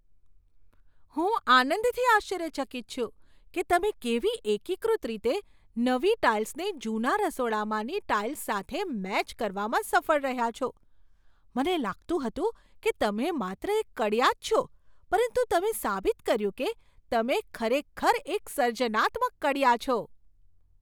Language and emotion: Gujarati, surprised